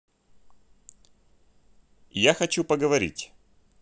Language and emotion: Russian, neutral